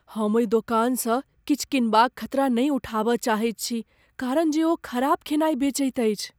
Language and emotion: Maithili, fearful